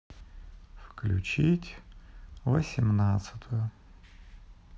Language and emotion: Russian, sad